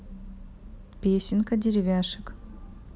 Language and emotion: Russian, neutral